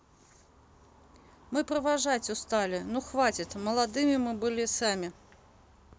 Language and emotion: Russian, neutral